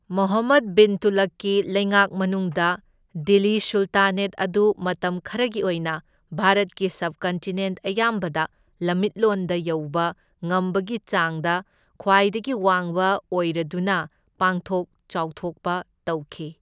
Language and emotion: Manipuri, neutral